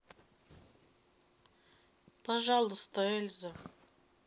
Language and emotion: Russian, sad